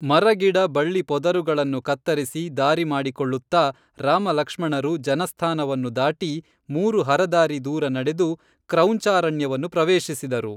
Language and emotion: Kannada, neutral